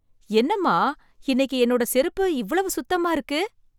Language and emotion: Tamil, surprised